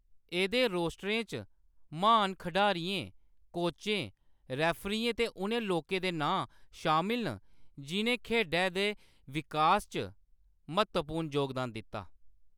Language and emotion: Dogri, neutral